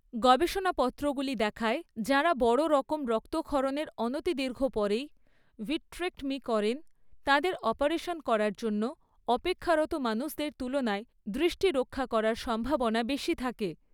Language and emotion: Bengali, neutral